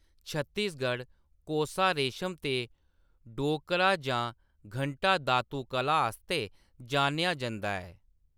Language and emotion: Dogri, neutral